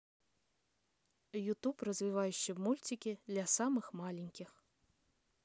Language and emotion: Russian, neutral